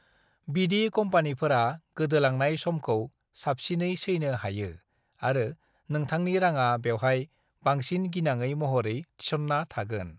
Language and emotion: Bodo, neutral